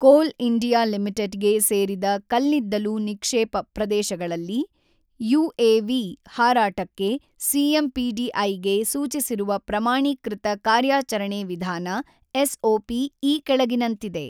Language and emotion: Kannada, neutral